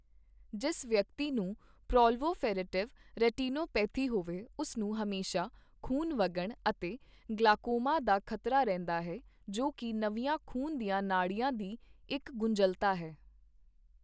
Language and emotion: Punjabi, neutral